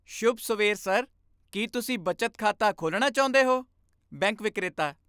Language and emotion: Punjabi, happy